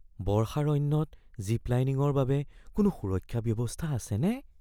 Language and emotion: Assamese, fearful